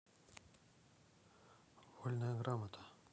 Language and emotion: Russian, neutral